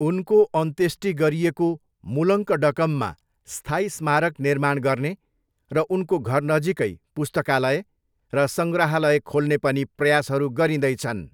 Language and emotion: Nepali, neutral